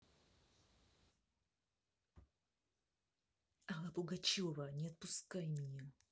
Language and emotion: Russian, neutral